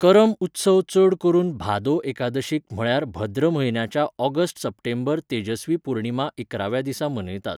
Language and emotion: Goan Konkani, neutral